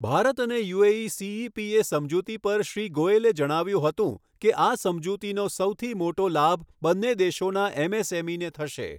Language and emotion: Gujarati, neutral